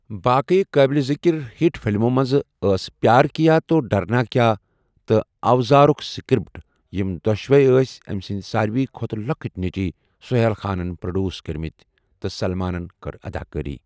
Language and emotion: Kashmiri, neutral